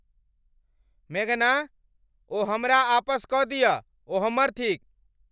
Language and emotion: Maithili, angry